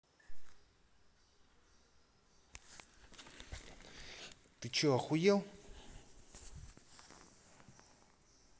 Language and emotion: Russian, angry